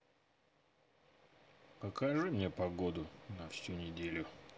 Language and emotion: Russian, neutral